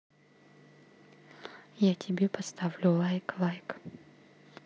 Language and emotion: Russian, neutral